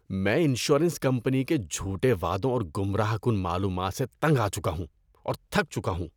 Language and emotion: Urdu, disgusted